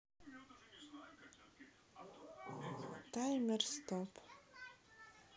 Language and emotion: Russian, neutral